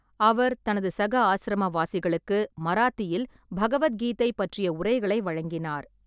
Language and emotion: Tamil, neutral